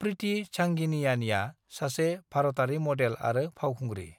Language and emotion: Bodo, neutral